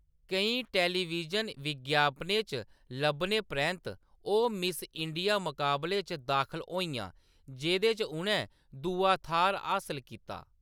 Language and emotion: Dogri, neutral